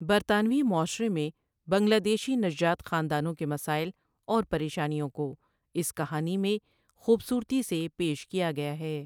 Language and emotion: Urdu, neutral